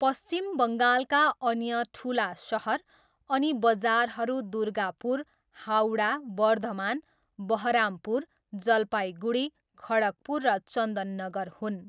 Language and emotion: Nepali, neutral